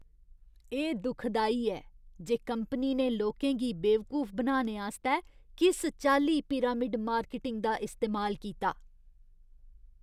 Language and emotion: Dogri, disgusted